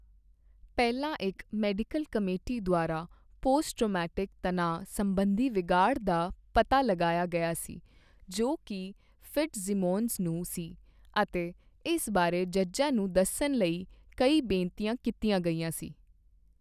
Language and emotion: Punjabi, neutral